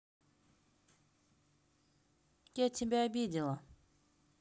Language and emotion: Russian, neutral